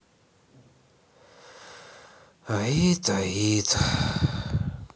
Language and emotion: Russian, sad